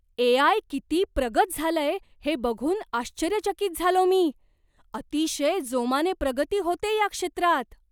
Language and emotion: Marathi, surprised